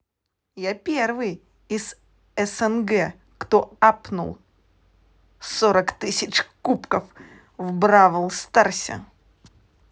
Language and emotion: Russian, positive